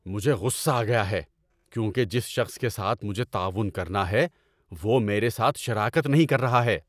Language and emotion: Urdu, angry